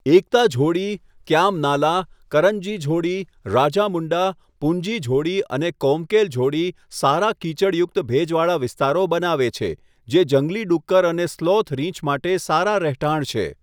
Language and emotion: Gujarati, neutral